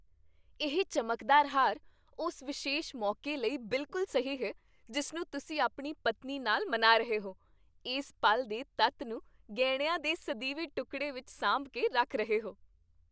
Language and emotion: Punjabi, happy